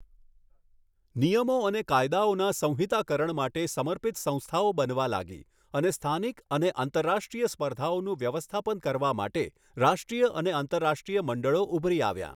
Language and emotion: Gujarati, neutral